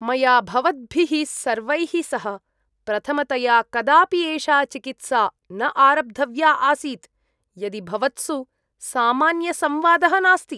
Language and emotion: Sanskrit, disgusted